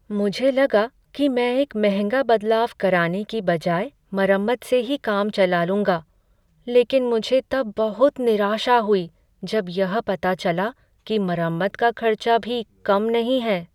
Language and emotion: Hindi, sad